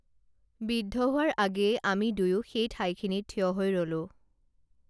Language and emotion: Assamese, neutral